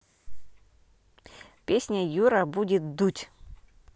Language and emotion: Russian, neutral